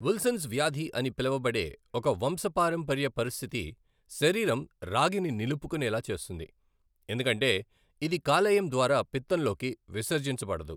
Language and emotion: Telugu, neutral